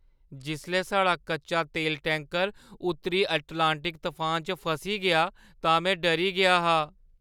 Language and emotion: Dogri, fearful